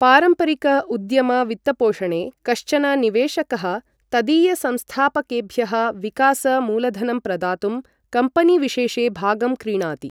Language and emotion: Sanskrit, neutral